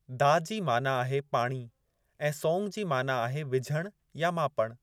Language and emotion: Sindhi, neutral